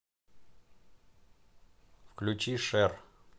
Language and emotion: Russian, neutral